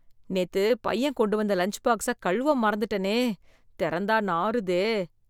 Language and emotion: Tamil, disgusted